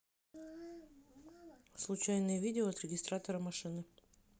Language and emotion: Russian, neutral